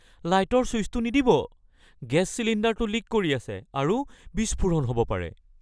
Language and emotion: Assamese, fearful